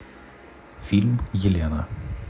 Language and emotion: Russian, neutral